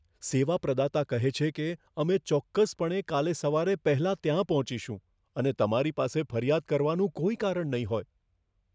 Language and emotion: Gujarati, fearful